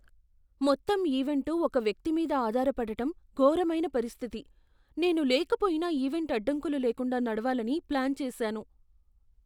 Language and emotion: Telugu, fearful